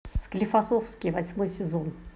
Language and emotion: Russian, positive